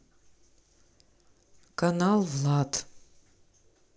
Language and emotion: Russian, neutral